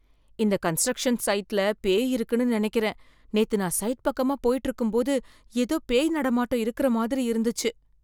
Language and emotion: Tamil, fearful